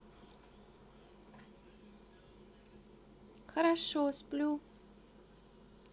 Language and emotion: Russian, neutral